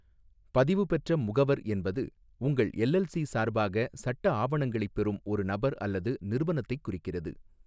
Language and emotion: Tamil, neutral